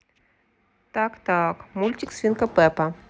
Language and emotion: Russian, neutral